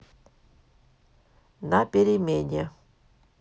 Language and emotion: Russian, neutral